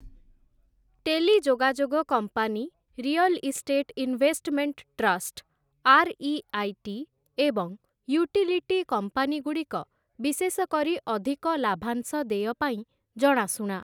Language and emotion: Odia, neutral